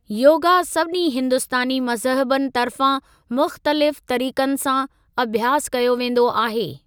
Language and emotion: Sindhi, neutral